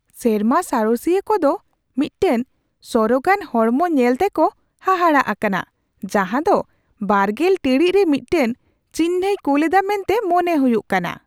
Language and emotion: Santali, surprised